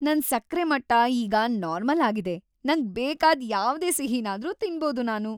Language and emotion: Kannada, happy